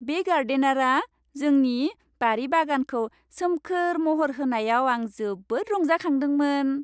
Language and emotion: Bodo, happy